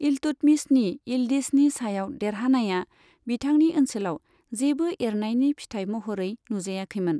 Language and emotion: Bodo, neutral